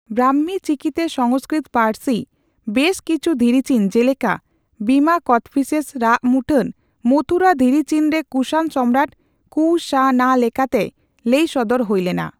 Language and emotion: Santali, neutral